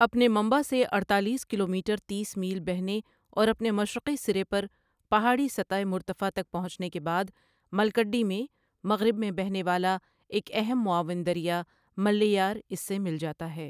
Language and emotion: Urdu, neutral